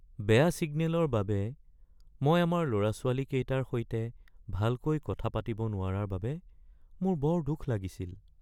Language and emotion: Assamese, sad